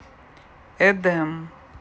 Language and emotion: Russian, neutral